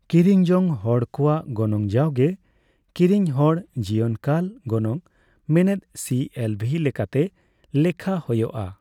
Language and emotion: Santali, neutral